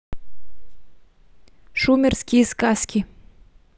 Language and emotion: Russian, neutral